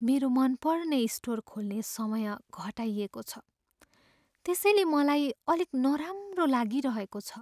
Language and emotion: Nepali, sad